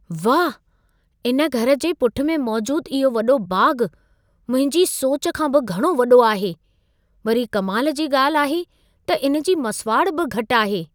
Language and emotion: Sindhi, surprised